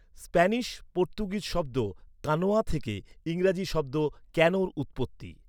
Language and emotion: Bengali, neutral